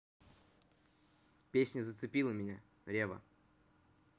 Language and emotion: Russian, neutral